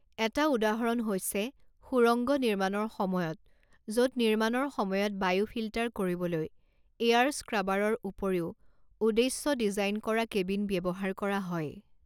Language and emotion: Assamese, neutral